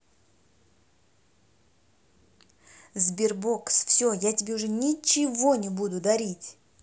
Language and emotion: Russian, angry